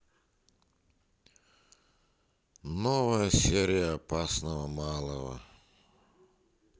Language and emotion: Russian, neutral